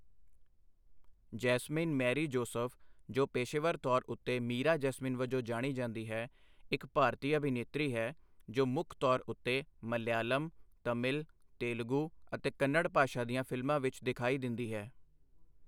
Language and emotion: Punjabi, neutral